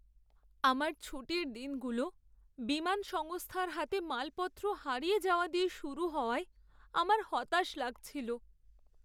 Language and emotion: Bengali, sad